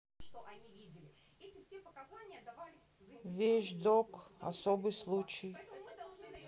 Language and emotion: Russian, neutral